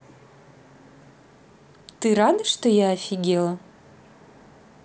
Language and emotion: Russian, positive